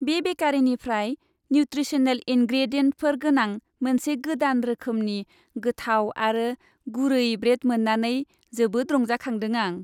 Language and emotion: Bodo, happy